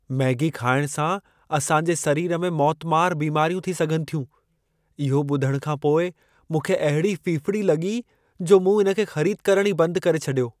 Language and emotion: Sindhi, fearful